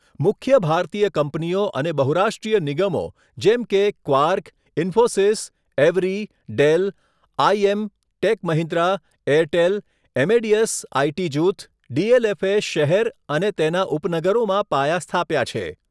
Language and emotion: Gujarati, neutral